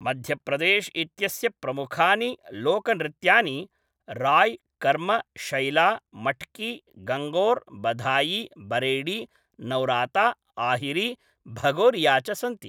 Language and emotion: Sanskrit, neutral